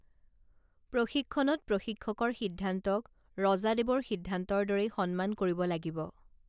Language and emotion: Assamese, neutral